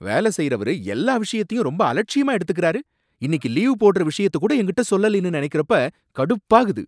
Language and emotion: Tamil, angry